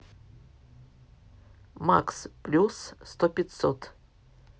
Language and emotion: Russian, neutral